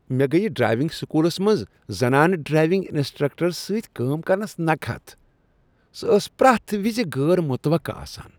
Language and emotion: Kashmiri, disgusted